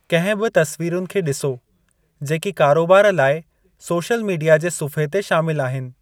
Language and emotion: Sindhi, neutral